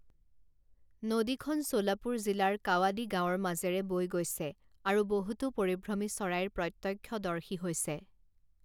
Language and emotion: Assamese, neutral